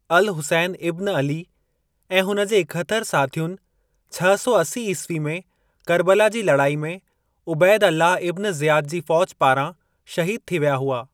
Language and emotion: Sindhi, neutral